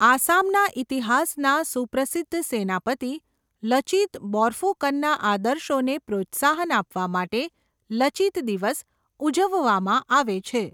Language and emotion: Gujarati, neutral